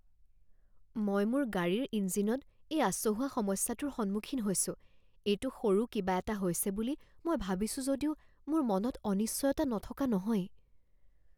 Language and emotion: Assamese, fearful